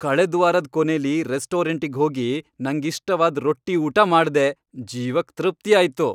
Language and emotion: Kannada, happy